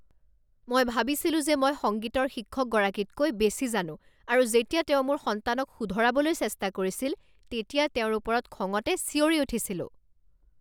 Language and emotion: Assamese, angry